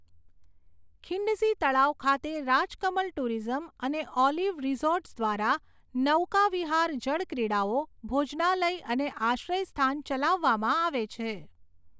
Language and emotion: Gujarati, neutral